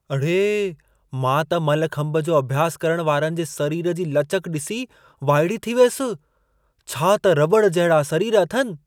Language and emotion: Sindhi, surprised